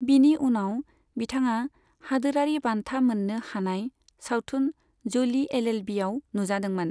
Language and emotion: Bodo, neutral